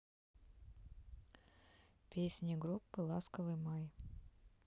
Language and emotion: Russian, neutral